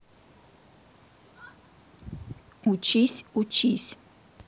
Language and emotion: Russian, neutral